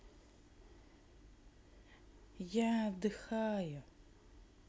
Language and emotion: Russian, neutral